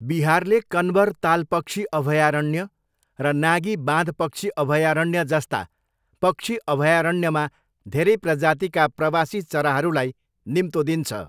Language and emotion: Nepali, neutral